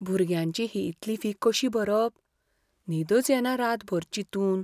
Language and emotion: Goan Konkani, fearful